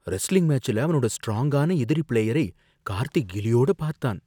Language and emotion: Tamil, fearful